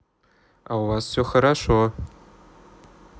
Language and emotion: Russian, neutral